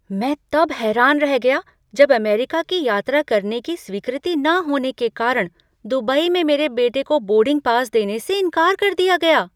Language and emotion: Hindi, surprised